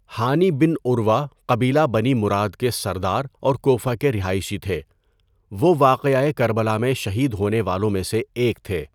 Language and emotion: Urdu, neutral